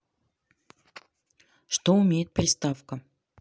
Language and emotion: Russian, neutral